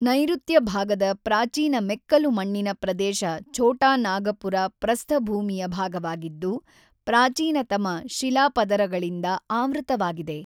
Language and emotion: Kannada, neutral